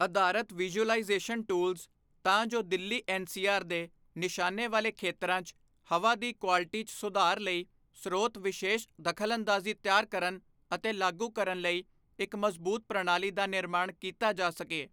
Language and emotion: Punjabi, neutral